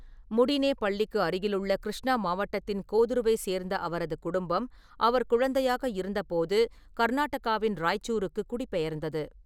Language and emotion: Tamil, neutral